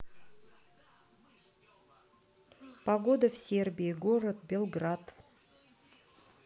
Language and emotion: Russian, neutral